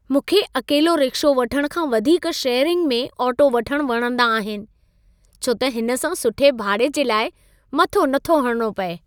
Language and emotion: Sindhi, happy